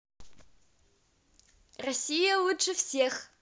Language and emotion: Russian, positive